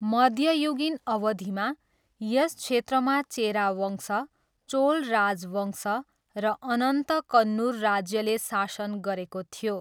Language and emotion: Nepali, neutral